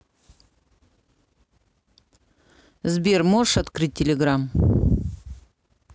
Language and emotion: Russian, neutral